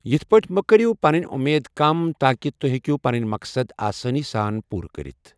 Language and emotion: Kashmiri, neutral